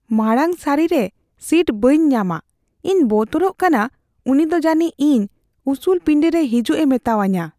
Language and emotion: Santali, fearful